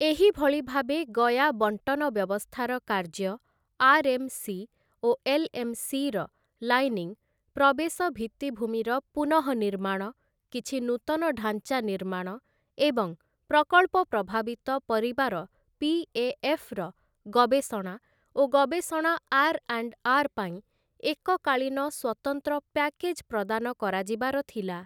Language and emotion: Odia, neutral